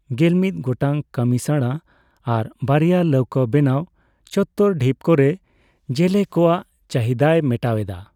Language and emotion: Santali, neutral